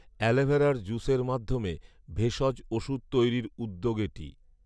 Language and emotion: Bengali, neutral